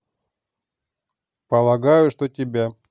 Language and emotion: Russian, neutral